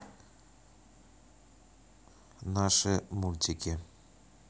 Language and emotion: Russian, neutral